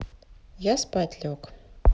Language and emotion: Russian, neutral